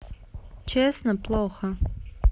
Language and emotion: Russian, sad